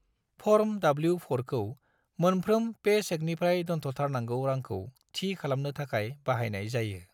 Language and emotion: Bodo, neutral